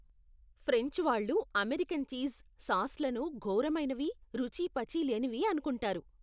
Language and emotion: Telugu, disgusted